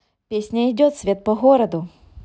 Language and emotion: Russian, positive